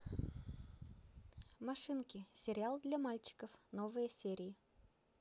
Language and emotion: Russian, positive